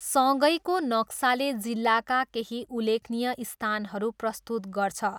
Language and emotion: Nepali, neutral